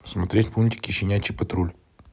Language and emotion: Russian, neutral